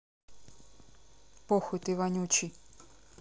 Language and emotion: Russian, neutral